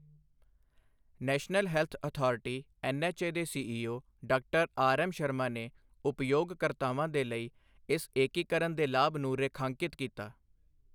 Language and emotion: Punjabi, neutral